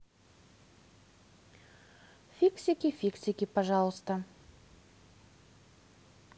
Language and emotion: Russian, neutral